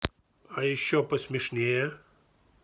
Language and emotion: Russian, neutral